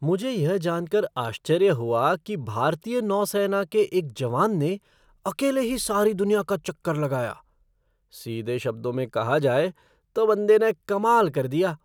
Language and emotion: Hindi, surprised